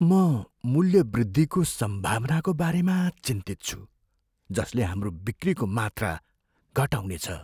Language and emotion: Nepali, fearful